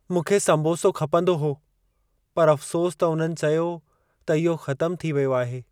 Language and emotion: Sindhi, sad